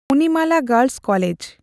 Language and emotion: Santali, neutral